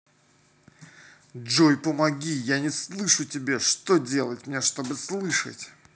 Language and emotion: Russian, angry